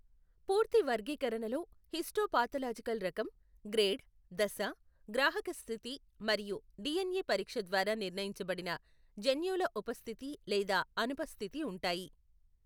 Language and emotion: Telugu, neutral